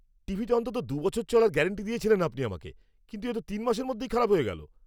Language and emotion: Bengali, angry